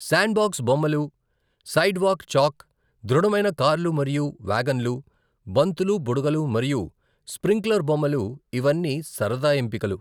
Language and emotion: Telugu, neutral